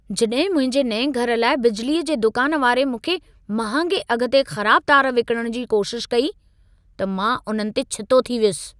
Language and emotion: Sindhi, angry